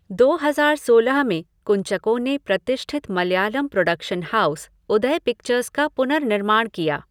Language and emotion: Hindi, neutral